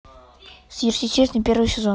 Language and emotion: Russian, neutral